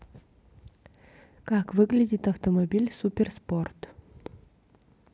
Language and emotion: Russian, neutral